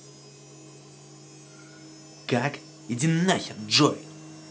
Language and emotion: Russian, angry